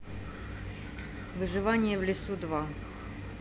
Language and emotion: Russian, neutral